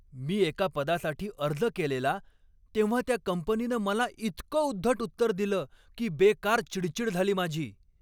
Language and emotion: Marathi, angry